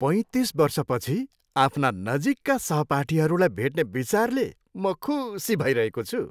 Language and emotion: Nepali, happy